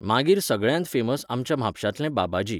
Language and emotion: Goan Konkani, neutral